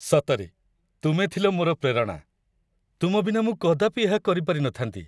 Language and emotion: Odia, happy